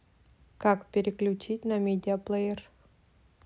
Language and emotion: Russian, neutral